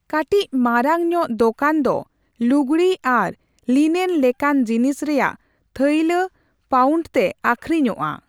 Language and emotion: Santali, neutral